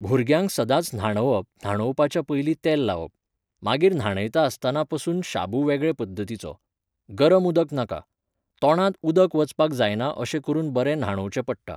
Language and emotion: Goan Konkani, neutral